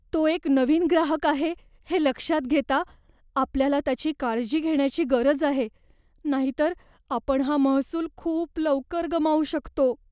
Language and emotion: Marathi, fearful